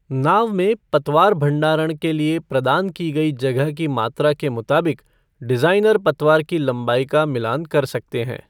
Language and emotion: Hindi, neutral